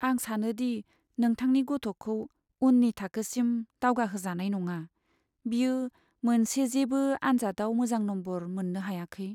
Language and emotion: Bodo, sad